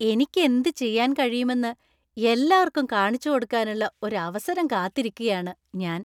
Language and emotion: Malayalam, happy